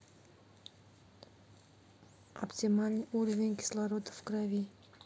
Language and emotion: Russian, neutral